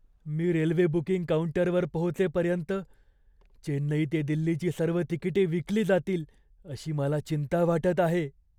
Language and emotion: Marathi, fearful